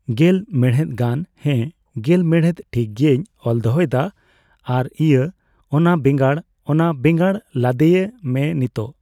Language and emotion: Santali, neutral